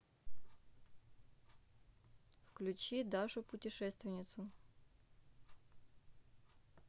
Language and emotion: Russian, neutral